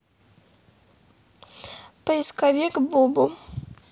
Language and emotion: Russian, neutral